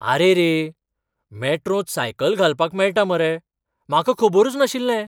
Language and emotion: Goan Konkani, surprised